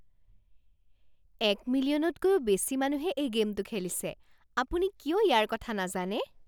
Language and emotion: Assamese, surprised